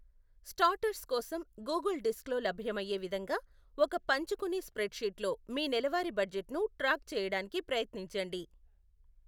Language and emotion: Telugu, neutral